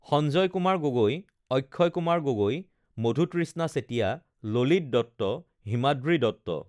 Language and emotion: Assamese, neutral